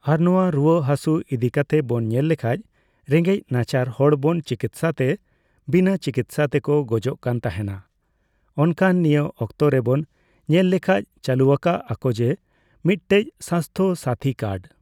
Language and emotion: Santali, neutral